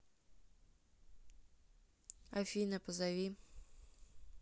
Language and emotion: Russian, neutral